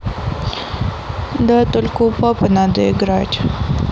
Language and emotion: Russian, sad